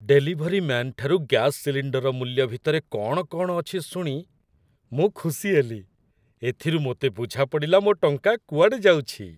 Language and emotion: Odia, happy